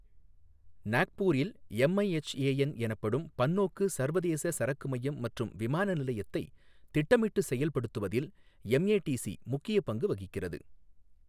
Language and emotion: Tamil, neutral